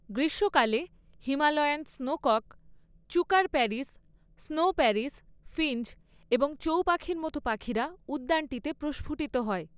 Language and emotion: Bengali, neutral